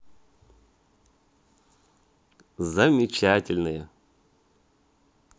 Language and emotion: Russian, positive